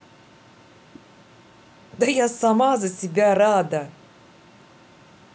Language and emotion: Russian, positive